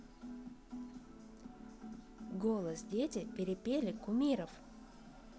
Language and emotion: Russian, neutral